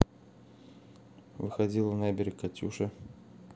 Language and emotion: Russian, neutral